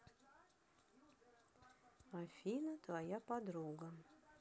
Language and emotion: Russian, neutral